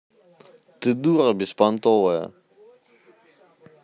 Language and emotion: Russian, neutral